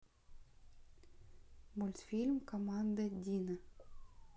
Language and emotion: Russian, neutral